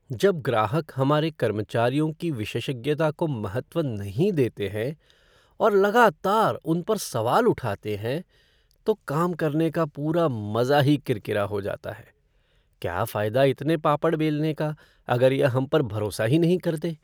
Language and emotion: Hindi, sad